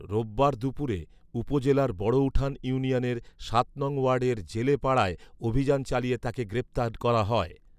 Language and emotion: Bengali, neutral